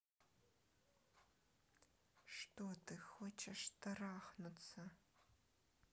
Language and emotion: Russian, neutral